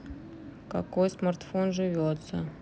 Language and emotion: Russian, sad